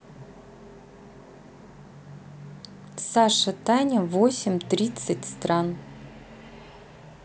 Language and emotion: Russian, neutral